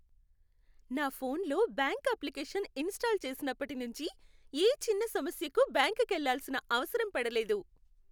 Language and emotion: Telugu, happy